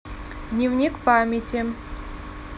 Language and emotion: Russian, neutral